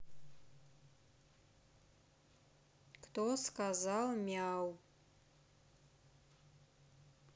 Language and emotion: Russian, neutral